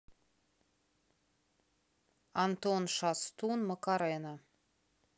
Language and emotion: Russian, neutral